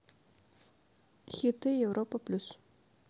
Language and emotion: Russian, neutral